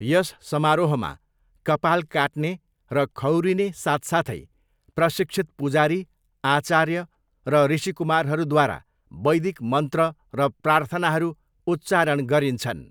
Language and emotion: Nepali, neutral